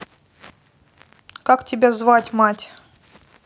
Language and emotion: Russian, neutral